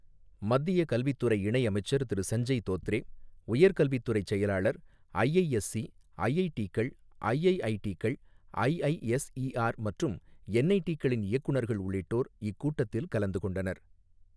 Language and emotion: Tamil, neutral